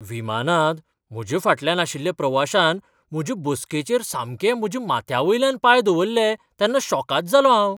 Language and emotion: Goan Konkani, surprised